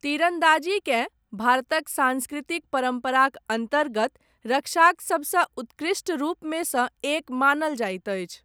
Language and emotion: Maithili, neutral